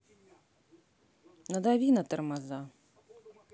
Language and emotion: Russian, neutral